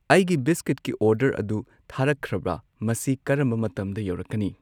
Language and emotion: Manipuri, neutral